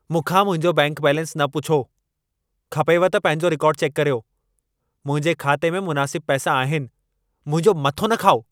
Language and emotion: Sindhi, angry